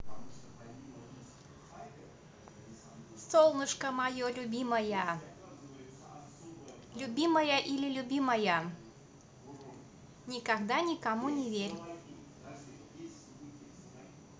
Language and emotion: Russian, positive